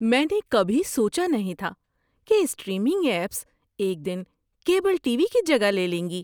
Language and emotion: Urdu, surprised